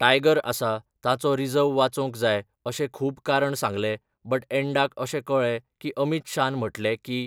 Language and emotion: Goan Konkani, neutral